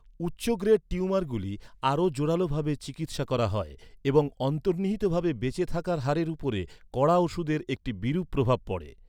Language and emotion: Bengali, neutral